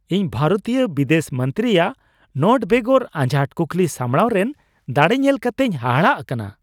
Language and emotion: Santali, surprised